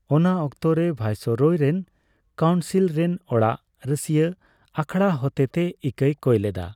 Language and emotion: Santali, neutral